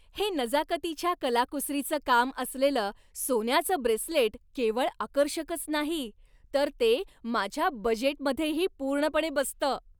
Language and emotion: Marathi, happy